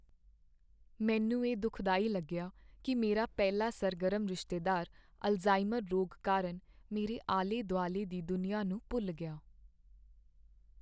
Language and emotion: Punjabi, sad